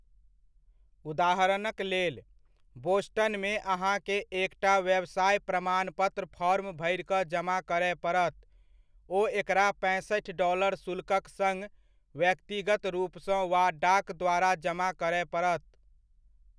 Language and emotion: Maithili, neutral